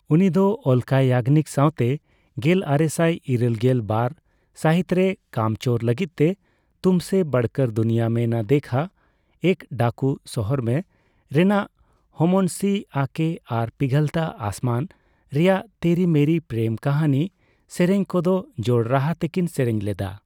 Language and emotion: Santali, neutral